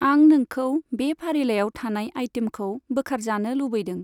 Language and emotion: Bodo, neutral